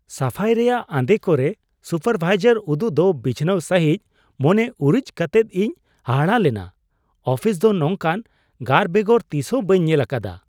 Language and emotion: Santali, surprised